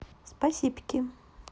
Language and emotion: Russian, positive